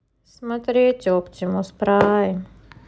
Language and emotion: Russian, sad